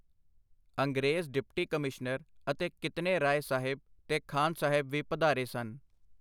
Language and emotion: Punjabi, neutral